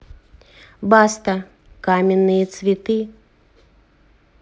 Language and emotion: Russian, neutral